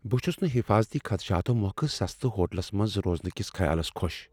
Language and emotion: Kashmiri, fearful